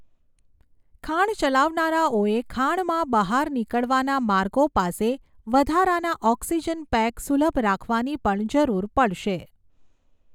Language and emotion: Gujarati, neutral